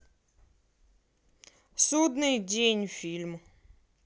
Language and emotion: Russian, neutral